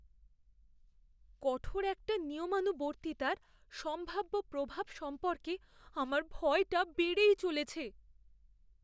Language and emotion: Bengali, fearful